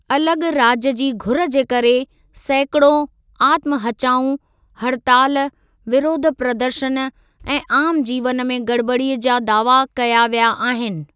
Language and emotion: Sindhi, neutral